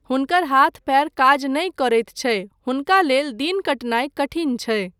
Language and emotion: Maithili, neutral